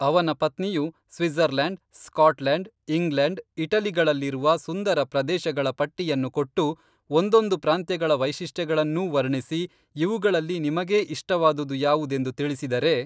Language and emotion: Kannada, neutral